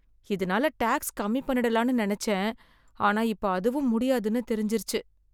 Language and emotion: Tamil, sad